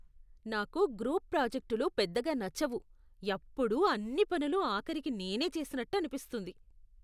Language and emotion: Telugu, disgusted